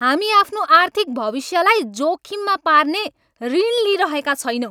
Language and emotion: Nepali, angry